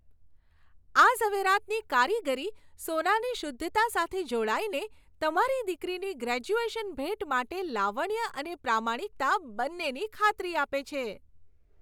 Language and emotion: Gujarati, happy